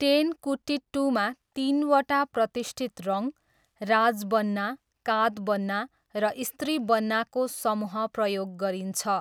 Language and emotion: Nepali, neutral